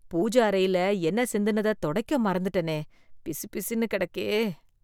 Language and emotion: Tamil, disgusted